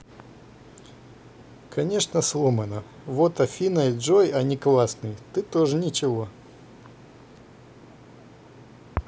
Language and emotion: Russian, positive